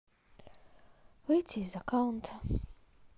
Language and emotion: Russian, sad